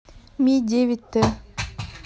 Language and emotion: Russian, neutral